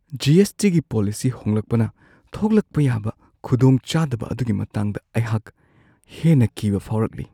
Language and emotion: Manipuri, fearful